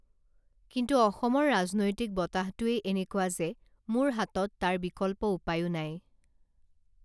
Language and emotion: Assamese, neutral